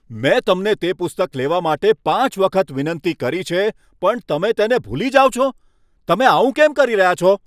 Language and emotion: Gujarati, angry